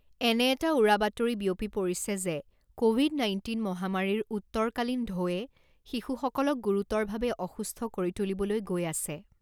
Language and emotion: Assamese, neutral